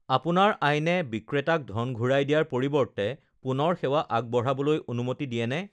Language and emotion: Assamese, neutral